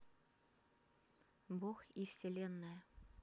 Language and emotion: Russian, neutral